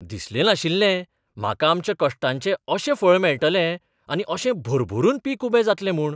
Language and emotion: Goan Konkani, surprised